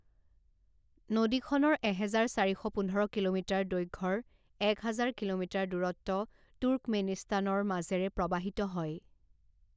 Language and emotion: Assamese, neutral